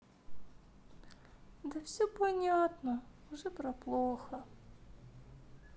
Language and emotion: Russian, sad